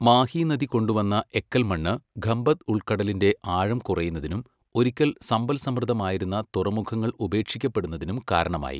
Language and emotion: Malayalam, neutral